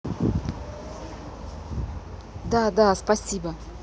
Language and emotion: Russian, neutral